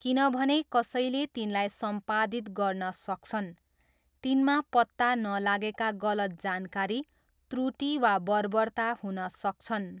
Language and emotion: Nepali, neutral